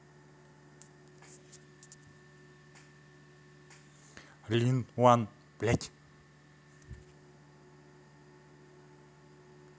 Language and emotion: Russian, angry